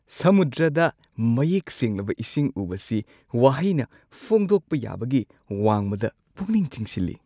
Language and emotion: Manipuri, surprised